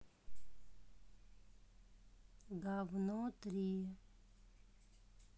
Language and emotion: Russian, neutral